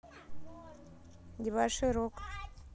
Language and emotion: Russian, neutral